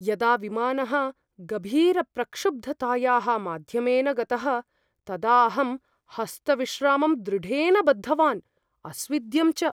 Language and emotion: Sanskrit, fearful